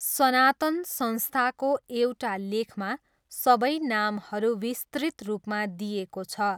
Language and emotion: Nepali, neutral